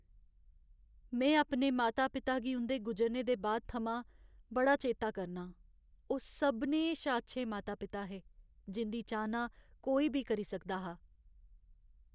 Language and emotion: Dogri, sad